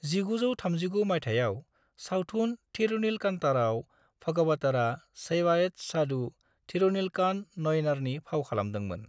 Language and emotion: Bodo, neutral